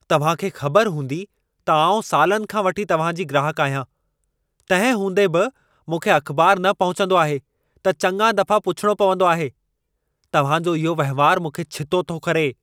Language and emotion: Sindhi, angry